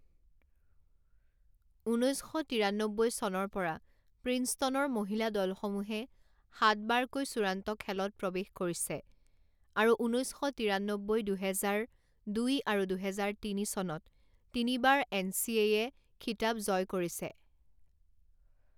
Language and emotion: Assamese, neutral